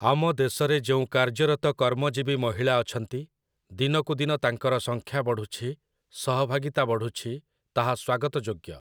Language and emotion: Odia, neutral